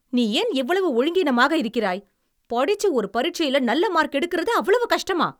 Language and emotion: Tamil, angry